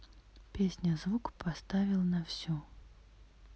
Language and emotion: Russian, neutral